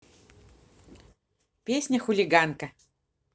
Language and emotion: Russian, positive